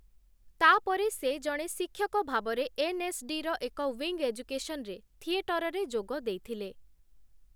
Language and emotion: Odia, neutral